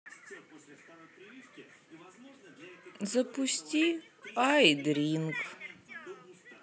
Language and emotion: Russian, sad